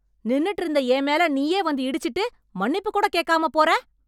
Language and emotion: Tamil, angry